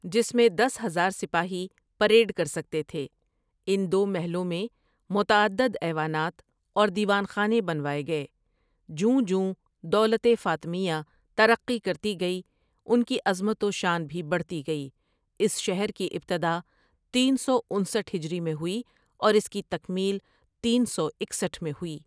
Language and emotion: Urdu, neutral